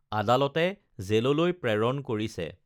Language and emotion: Assamese, neutral